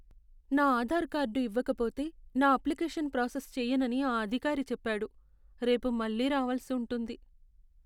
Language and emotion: Telugu, sad